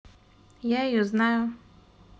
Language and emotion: Russian, neutral